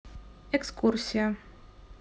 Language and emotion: Russian, neutral